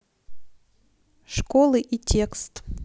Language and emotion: Russian, neutral